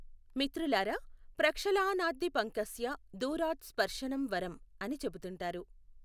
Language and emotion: Telugu, neutral